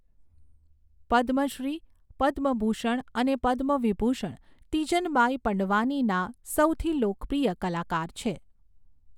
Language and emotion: Gujarati, neutral